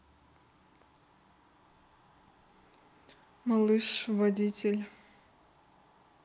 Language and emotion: Russian, neutral